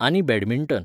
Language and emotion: Goan Konkani, neutral